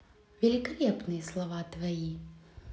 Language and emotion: Russian, positive